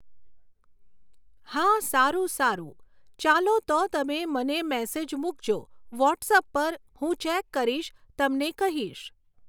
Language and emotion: Gujarati, neutral